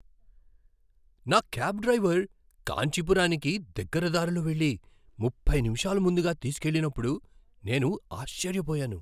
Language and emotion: Telugu, surprised